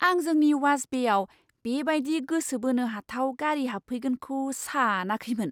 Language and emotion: Bodo, surprised